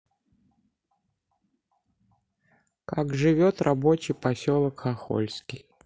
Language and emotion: Russian, neutral